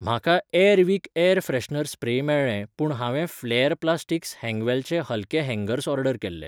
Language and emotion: Goan Konkani, neutral